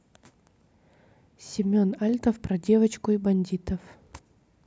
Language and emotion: Russian, neutral